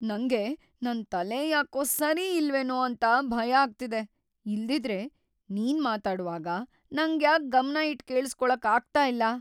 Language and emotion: Kannada, fearful